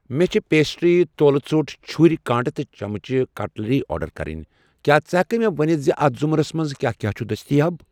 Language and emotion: Kashmiri, neutral